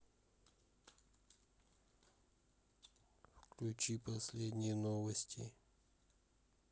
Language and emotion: Russian, neutral